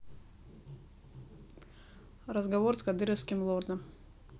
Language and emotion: Russian, neutral